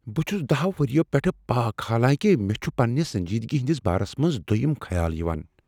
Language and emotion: Kashmiri, fearful